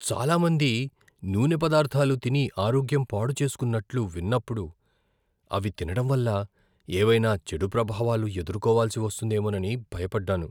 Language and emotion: Telugu, fearful